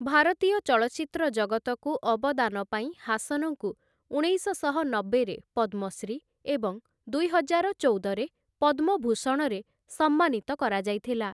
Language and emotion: Odia, neutral